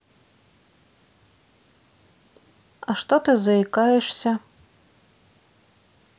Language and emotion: Russian, neutral